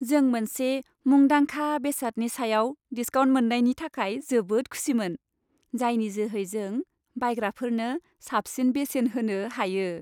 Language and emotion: Bodo, happy